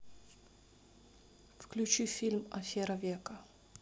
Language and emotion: Russian, neutral